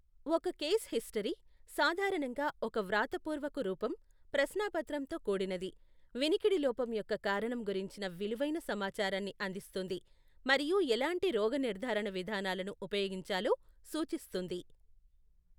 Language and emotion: Telugu, neutral